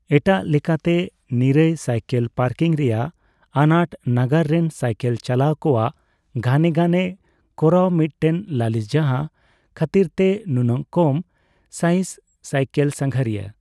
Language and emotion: Santali, neutral